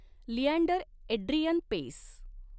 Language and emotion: Marathi, neutral